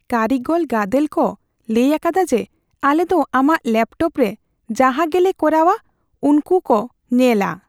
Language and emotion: Santali, fearful